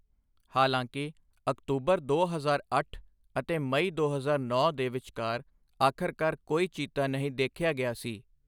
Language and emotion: Punjabi, neutral